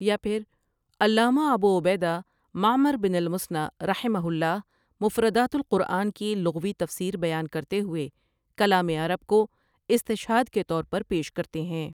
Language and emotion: Urdu, neutral